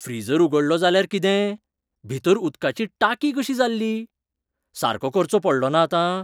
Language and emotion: Goan Konkani, surprised